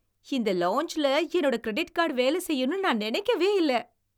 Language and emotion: Tamil, surprised